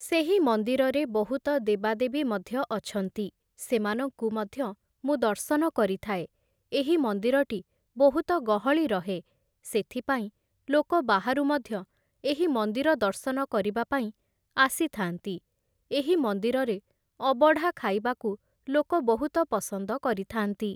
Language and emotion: Odia, neutral